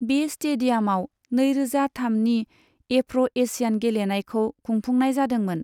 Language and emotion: Bodo, neutral